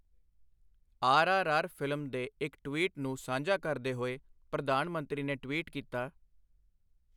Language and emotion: Punjabi, neutral